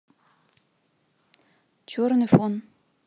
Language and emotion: Russian, neutral